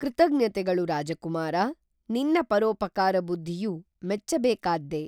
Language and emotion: Kannada, neutral